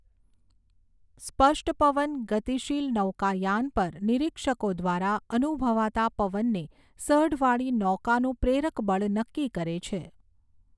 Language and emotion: Gujarati, neutral